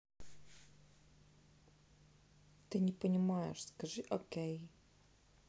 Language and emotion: Russian, neutral